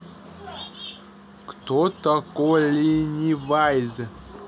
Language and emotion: Russian, neutral